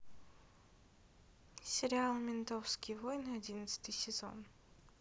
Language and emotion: Russian, neutral